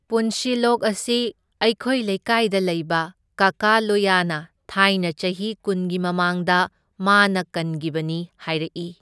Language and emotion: Manipuri, neutral